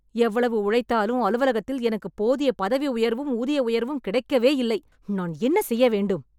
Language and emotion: Tamil, angry